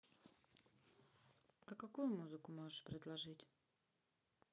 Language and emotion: Russian, sad